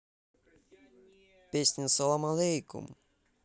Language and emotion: Russian, positive